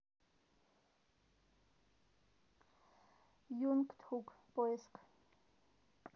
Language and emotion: Russian, neutral